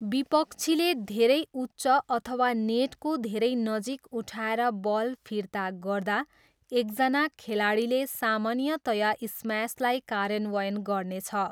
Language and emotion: Nepali, neutral